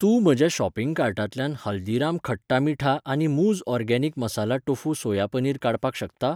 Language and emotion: Goan Konkani, neutral